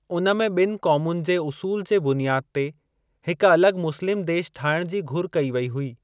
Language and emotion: Sindhi, neutral